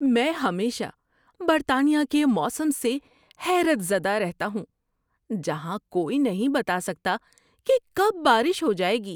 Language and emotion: Urdu, surprised